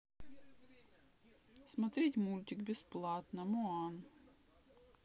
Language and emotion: Russian, neutral